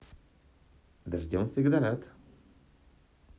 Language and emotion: Russian, positive